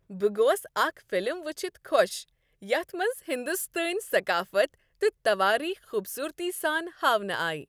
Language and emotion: Kashmiri, happy